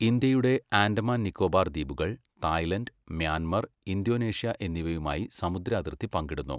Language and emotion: Malayalam, neutral